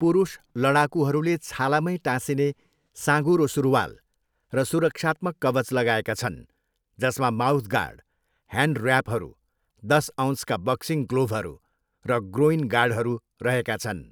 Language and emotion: Nepali, neutral